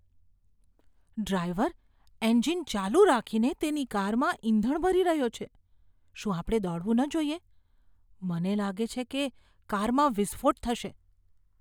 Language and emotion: Gujarati, fearful